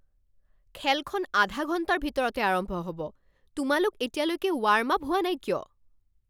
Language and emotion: Assamese, angry